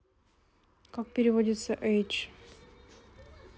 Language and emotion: Russian, neutral